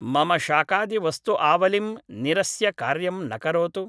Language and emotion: Sanskrit, neutral